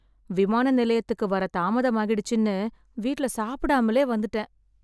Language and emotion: Tamil, sad